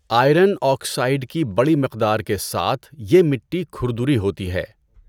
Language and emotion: Urdu, neutral